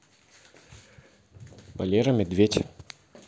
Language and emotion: Russian, neutral